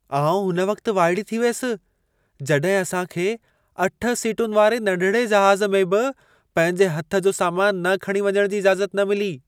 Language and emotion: Sindhi, surprised